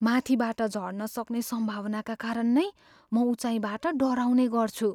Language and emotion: Nepali, fearful